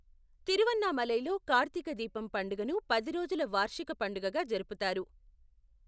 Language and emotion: Telugu, neutral